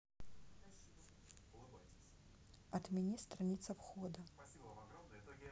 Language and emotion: Russian, neutral